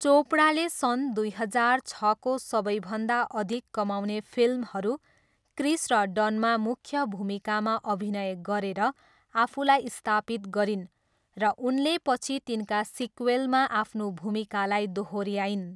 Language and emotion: Nepali, neutral